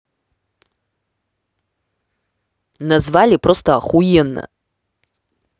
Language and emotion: Russian, angry